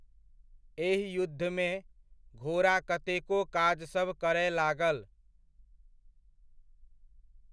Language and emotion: Maithili, neutral